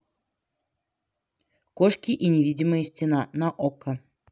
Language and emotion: Russian, neutral